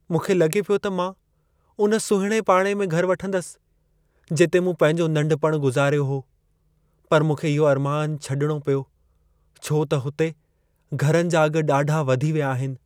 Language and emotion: Sindhi, sad